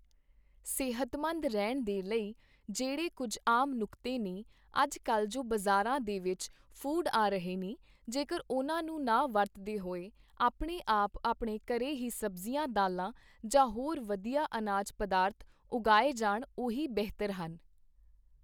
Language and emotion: Punjabi, neutral